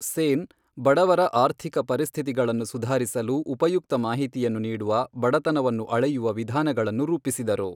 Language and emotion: Kannada, neutral